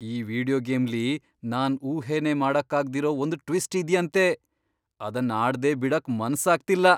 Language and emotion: Kannada, surprised